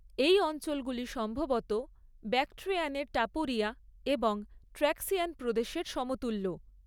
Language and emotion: Bengali, neutral